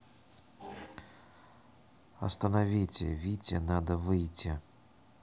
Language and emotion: Russian, neutral